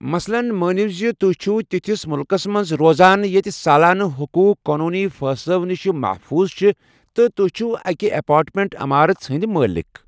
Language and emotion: Kashmiri, neutral